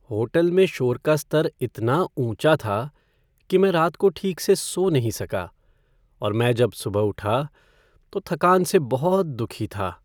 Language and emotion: Hindi, sad